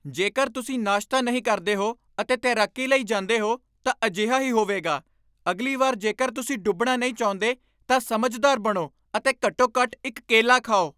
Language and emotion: Punjabi, angry